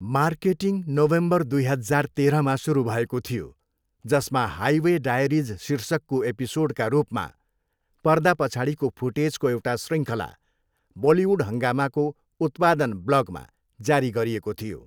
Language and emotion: Nepali, neutral